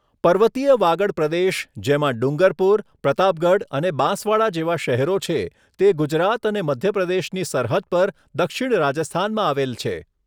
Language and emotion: Gujarati, neutral